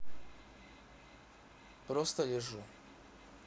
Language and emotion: Russian, neutral